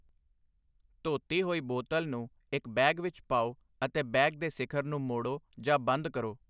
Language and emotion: Punjabi, neutral